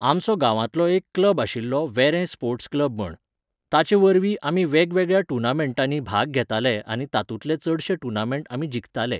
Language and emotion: Goan Konkani, neutral